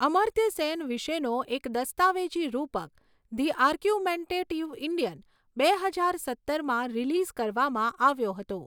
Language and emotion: Gujarati, neutral